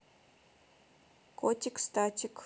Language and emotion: Russian, neutral